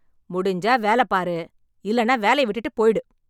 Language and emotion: Tamil, angry